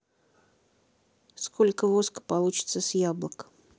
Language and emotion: Russian, neutral